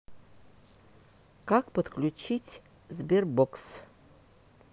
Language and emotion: Russian, neutral